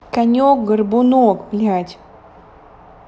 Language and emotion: Russian, angry